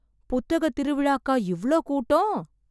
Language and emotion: Tamil, surprised